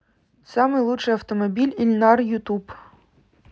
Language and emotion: Russian, neutral